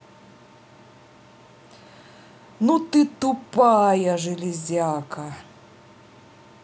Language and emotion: Russian, angry